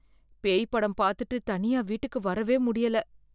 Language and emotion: Tamil, fearful